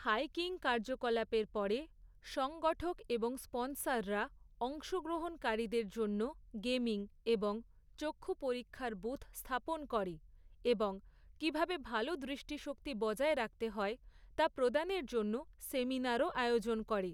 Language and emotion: Bengali, neutral